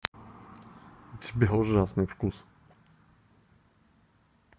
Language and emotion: Russian, neutral